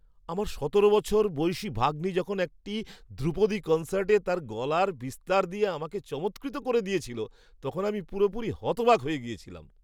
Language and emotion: Bengali, surprised